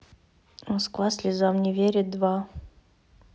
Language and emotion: Russian, neutral